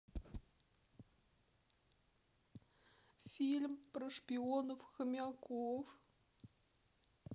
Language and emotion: Russian, sad